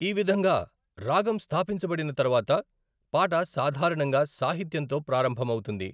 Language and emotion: Telugu, neutral